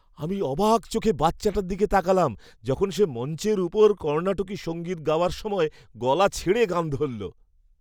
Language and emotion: Bengali, happy